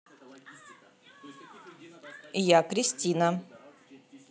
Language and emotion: Russian, neutral